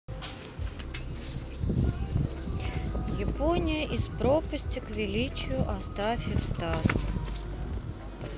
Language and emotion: Russian, neutral